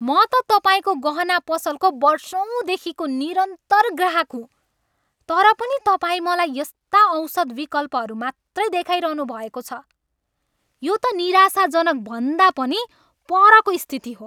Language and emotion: Nepali, angry